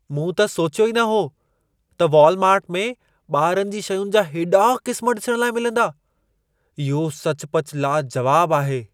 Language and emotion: Sindhi, surprised